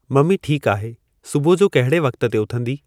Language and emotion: Sindhi, neutral